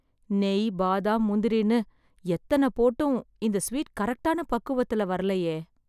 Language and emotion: Tamil, sad